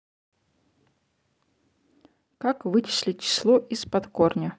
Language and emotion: Russian, neutral